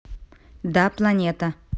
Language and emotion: Russian, neutral